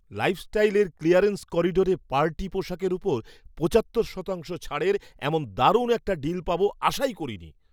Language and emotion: Bengali, surprised